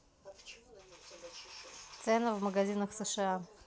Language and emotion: Russian, neutral